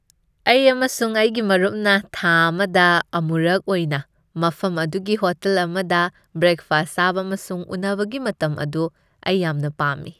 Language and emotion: Manipuri, happy